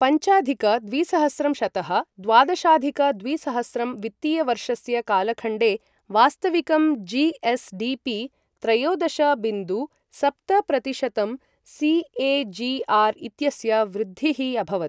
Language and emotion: Sanskrit, neutral